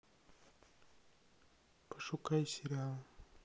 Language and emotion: Russian, sad